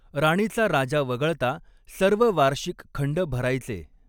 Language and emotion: Marathi, neutral